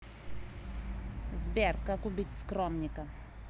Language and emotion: Russian, neutral